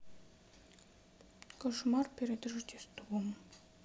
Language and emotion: Russian, sad